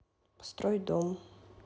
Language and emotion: Russian, neutral